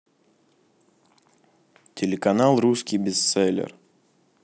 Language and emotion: Russian, neutral